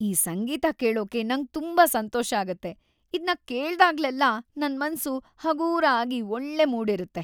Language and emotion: Kannada, happy